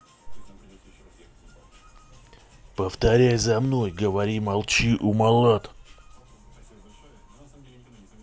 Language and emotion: Russian, angry